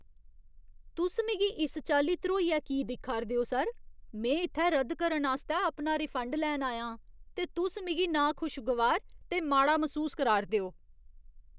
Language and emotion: Dogri, disgusted